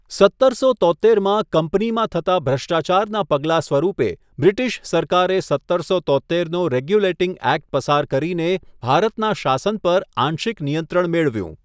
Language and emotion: Gujarati, neutral